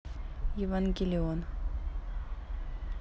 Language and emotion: Russian, neutral